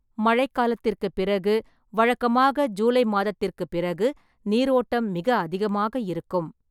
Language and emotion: Tamil, neutral